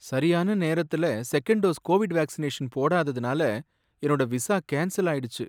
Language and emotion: Tamil, sad